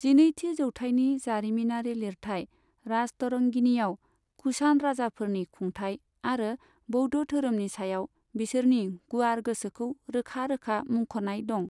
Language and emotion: Bodo, neutral